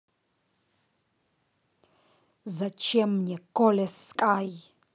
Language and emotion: Russian, angry